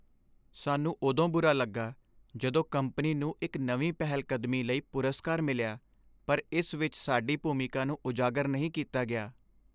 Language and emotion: Punjabi, sad